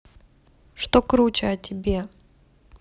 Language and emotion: Russian, neutral